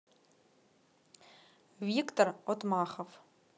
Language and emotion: Russian, neutral